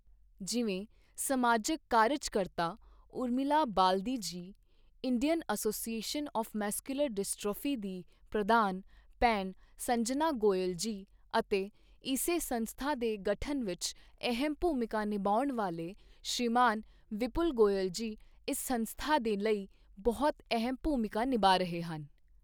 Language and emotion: Punjabi, neutral